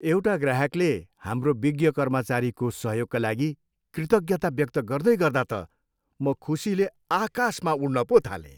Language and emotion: Nepali, happy